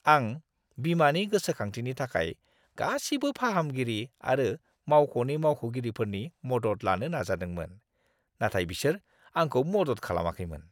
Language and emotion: Bodo, disgusted